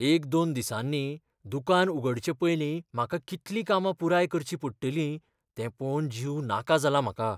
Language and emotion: Goan Konkani, fearful